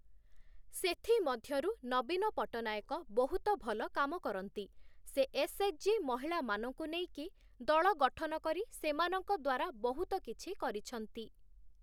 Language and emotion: Odia, neutral